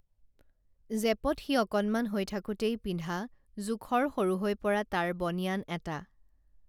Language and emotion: Assamese, neutral